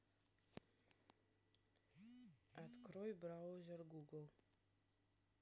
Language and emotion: Russian, neutral